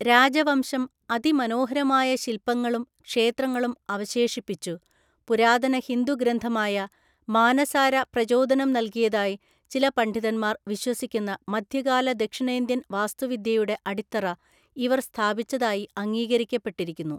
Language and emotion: Malayalam, neutral